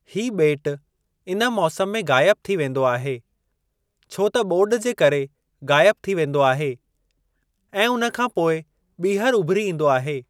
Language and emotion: Sindhi, neutral